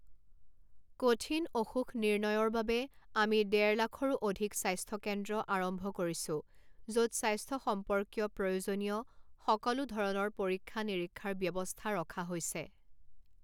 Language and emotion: Assamese, neutral